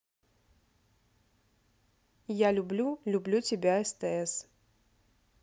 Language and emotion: Russian, neutral